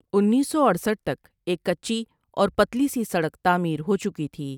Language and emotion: Urdu, neutral